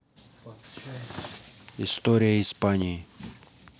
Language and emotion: Russian, neutral